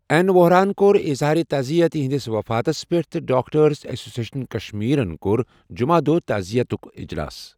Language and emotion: Kashmiri, neutral